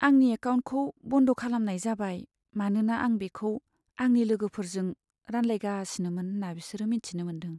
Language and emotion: Bodo, sad